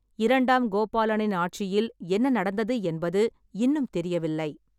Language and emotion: Tamil, neutral